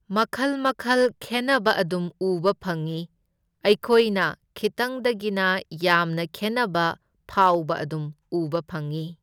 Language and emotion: Manipuri, neutral